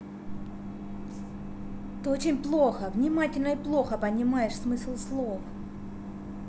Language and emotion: Russian, angry